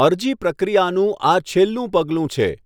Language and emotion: Gujarati, neutral